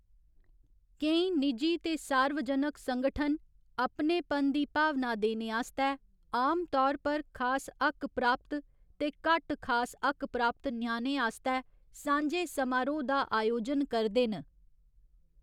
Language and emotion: Dogri, neutral